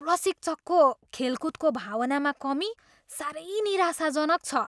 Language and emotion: Nepali, disgusted